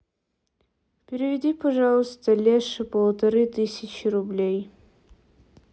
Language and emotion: Russian, neutral